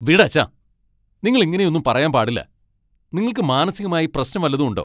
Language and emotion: Malayalam, angry